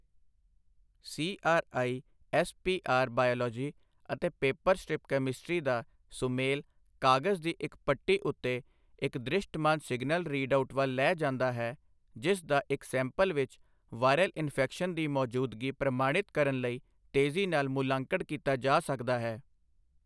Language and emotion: Punjabi, neutral